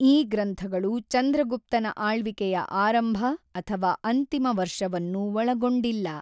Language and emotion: Kannada, neutral